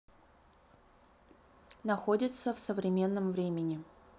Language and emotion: Russian, neutral